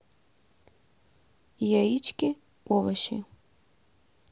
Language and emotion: Russian, neutral